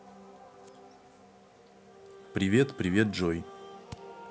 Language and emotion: Russian, neutral